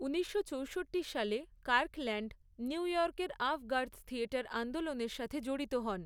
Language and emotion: Bengali, neutral